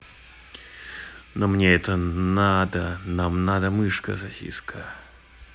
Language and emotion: Russian, neutral